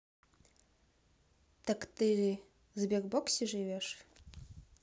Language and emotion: Russian, neutral